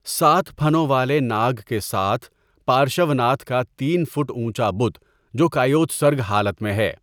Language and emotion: Urdu, neutral